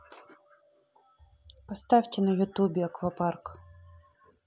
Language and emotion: Russian, neutral